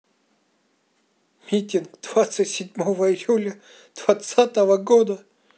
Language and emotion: Russian, neutral